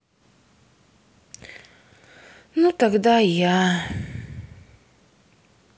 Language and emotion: Russian, sad